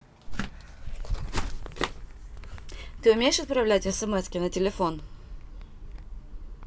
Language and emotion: Russian, neutral